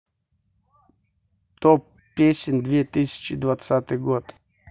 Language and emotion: Russian, neutral